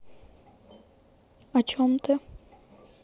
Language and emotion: Russian, neutral